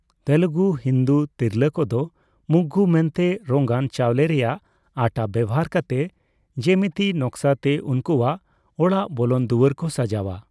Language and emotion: Santali, neutral